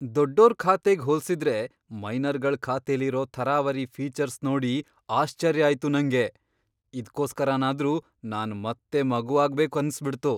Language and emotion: Kannada, surprised